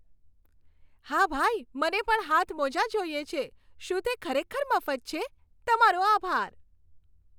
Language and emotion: Gujarati, happy